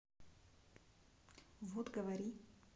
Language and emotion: Russian, neutral